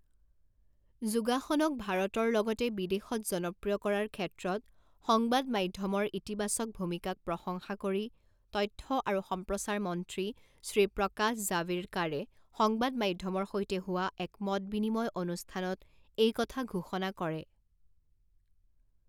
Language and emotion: Assamese, neutral